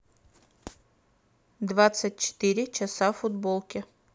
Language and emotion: Russian, neutral